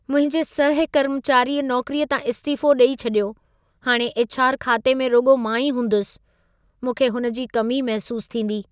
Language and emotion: Sindhi, sad